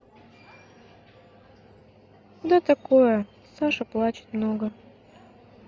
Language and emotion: Russian, sad